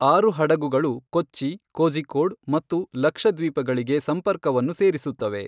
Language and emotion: Kannada, neutral